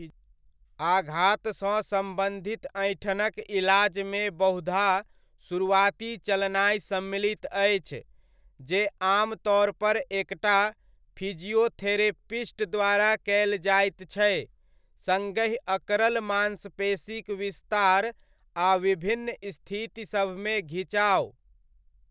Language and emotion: Maithili, neutral